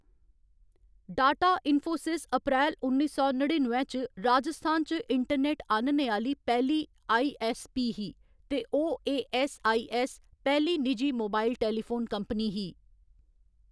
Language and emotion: Dogri, neutral